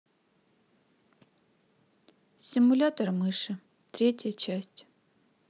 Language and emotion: Russian, neutral